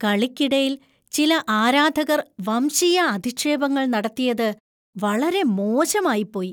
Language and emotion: Malayalam, disgusted